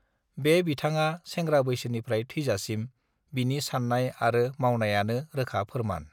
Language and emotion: Bodo, neutral